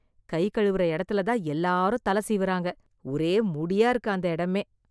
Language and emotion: Tamil, disgusted